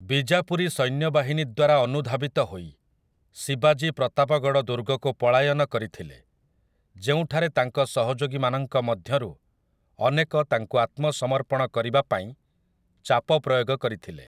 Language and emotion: Odia, neutral